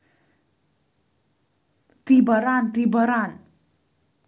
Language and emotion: Russian, neutral